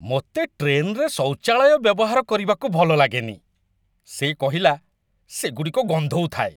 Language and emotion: Odia, disgusted